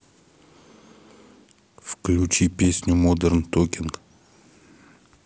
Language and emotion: Russian, neutral